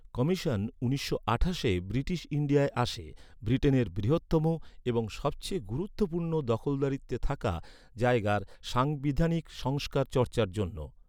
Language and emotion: Bengali, neutral